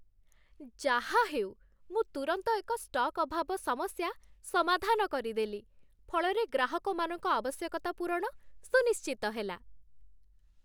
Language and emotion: Odia, happy